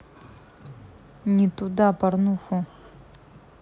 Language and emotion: Russian, angry